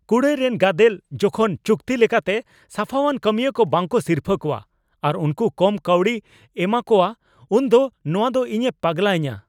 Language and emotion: Santali, angry